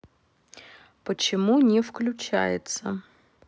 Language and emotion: Russian, neutral